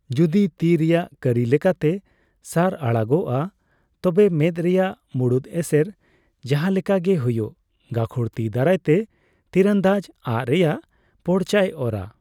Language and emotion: Santali, neutral